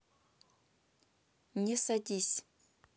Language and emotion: Russian, neutral